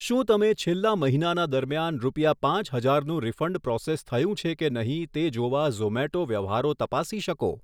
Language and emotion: Gujarati, neutral